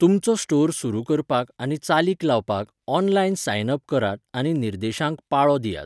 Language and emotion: Goan Konkani, neutral